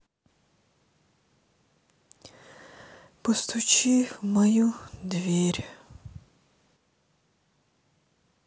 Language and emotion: Russian, sad